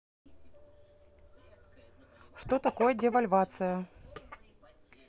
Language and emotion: Russian, neutral